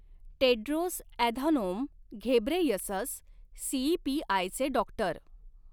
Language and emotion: Marathi, neutral